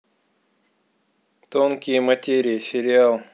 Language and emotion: Russian, neutral